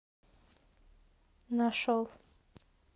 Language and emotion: Russian, neutral